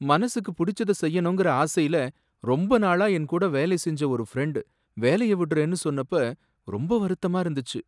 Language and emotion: Tamil, sad